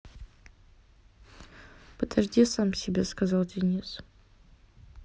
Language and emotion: Russian, neutral